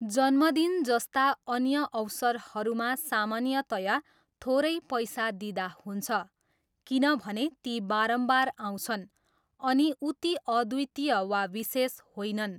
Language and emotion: Nepali, neutral